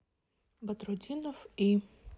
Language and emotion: Russian, neutral